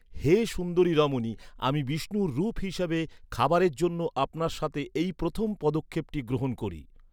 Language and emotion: Bengali, neutral